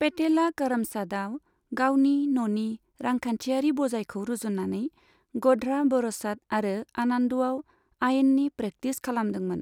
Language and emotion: Bodo, neutral